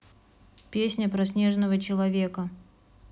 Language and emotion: Russian, neutral